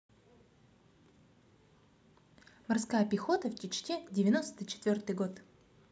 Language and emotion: Russian, positive